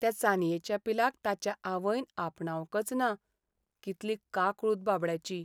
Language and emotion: Goan Konkani, sad